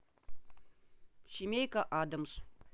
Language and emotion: Russian, neutral